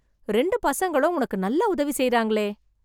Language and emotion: Tamil, surprised